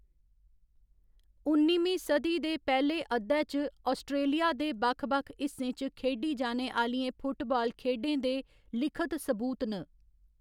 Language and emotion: Dogri, neutral